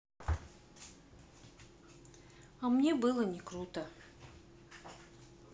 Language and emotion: Russian, sad